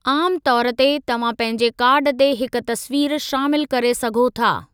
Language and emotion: Sindhi, neutral